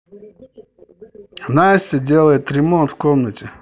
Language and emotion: Russian, neutral